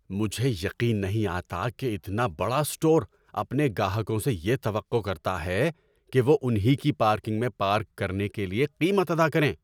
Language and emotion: Urdu, angry